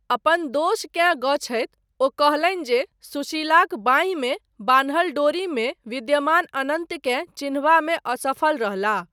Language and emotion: Maithili, neutral